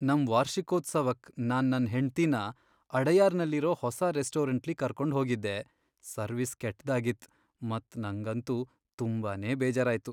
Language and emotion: Kannada, sad